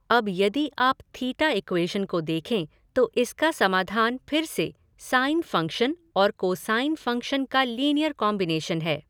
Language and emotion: Hindi, neutral